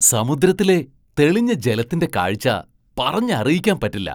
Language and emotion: Malayalam, surprised